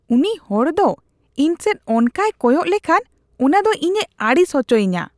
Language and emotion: Santali, disgusted